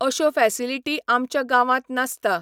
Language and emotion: Goan Konkani, neutral